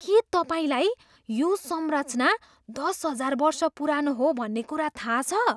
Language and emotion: Nepali, surprised